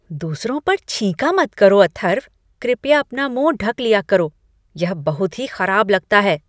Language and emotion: Hindi, disgusted